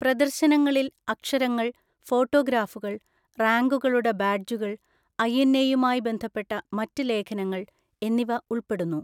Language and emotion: Malayalam, neutral